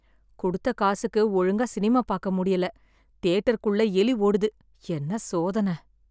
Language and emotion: Tamil, sad